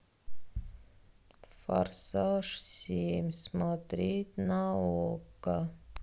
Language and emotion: Russian, sad